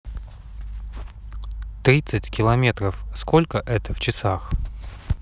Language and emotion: Russian, neutral